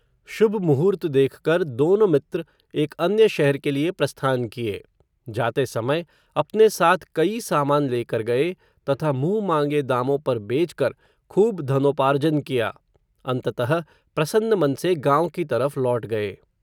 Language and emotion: Hindi, neutral